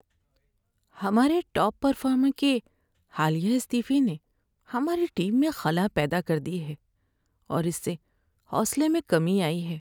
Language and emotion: Urdu, sad